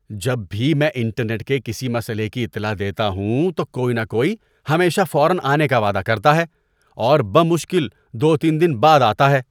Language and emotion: Urdu, disgusted